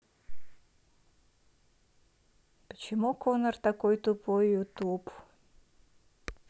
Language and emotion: Russian, neutral